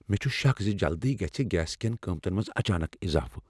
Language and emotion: Kashmiri, fearful